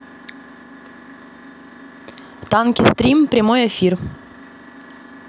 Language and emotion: Russian, neutral